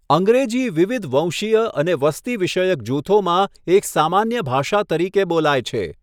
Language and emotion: Gujarati, neutral